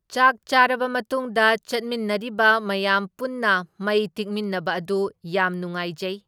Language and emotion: Manipuri, neutral